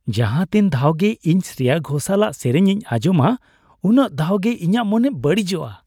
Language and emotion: Santali, happy